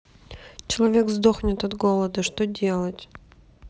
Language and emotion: Russian, sad